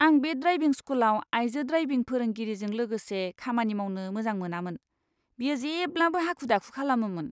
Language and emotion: Bodo, disgusted